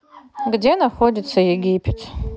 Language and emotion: Russian, neutral